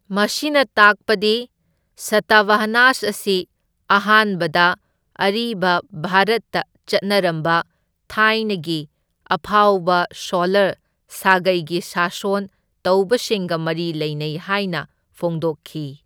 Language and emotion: Manipuri, neutral